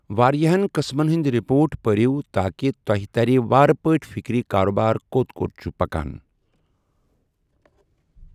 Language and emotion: Kashmiri, neutral